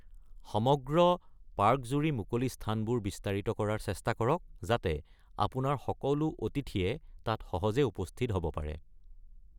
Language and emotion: Assamese, neutral